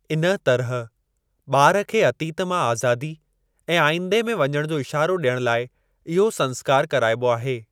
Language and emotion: Sindhi, neutral